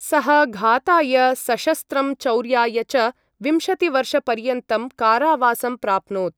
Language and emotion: Sanskrit, neutral